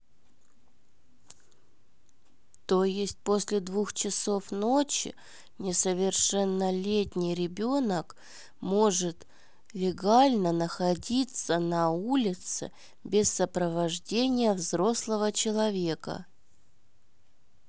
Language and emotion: Russian, neutral